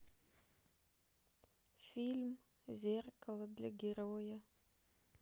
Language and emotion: Russian, sad